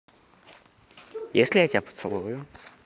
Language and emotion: Russian, positive